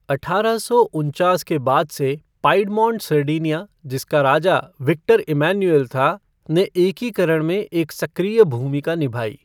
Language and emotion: Hindi, neutral